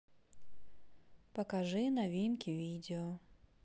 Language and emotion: Russian, neutral